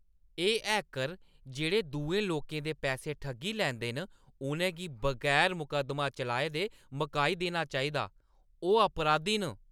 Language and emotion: Dogri, angry